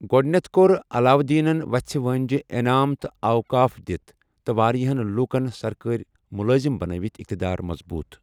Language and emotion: Kashmiri, neutral